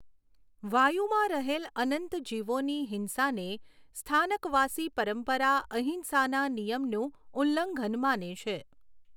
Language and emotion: Gujarati, neutral